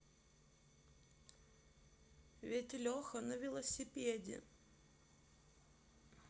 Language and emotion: Russian, sad